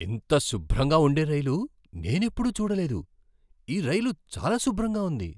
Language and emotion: Telugu, surprised